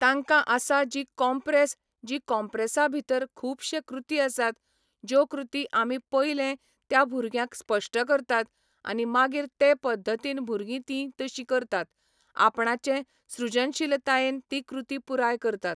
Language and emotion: Goan Konkani, neutral